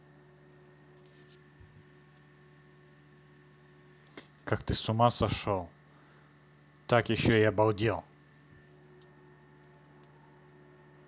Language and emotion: Russian, neutral